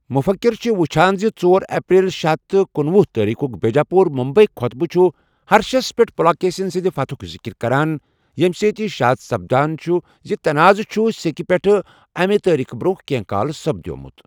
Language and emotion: Kashmiri, neutral